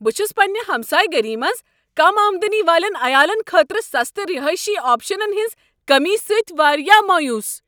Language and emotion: Kashmiri, angry